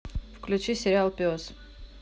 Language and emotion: Russian, neutral